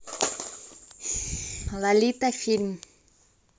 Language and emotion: Russian, neutral